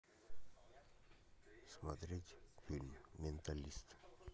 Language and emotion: Russian, neutral